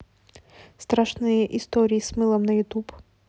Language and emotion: Russian, neutral